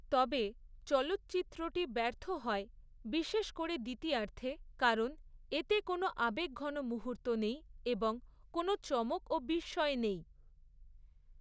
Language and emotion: Bengali, neutral